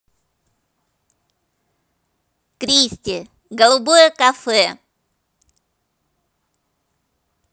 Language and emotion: Russian, positive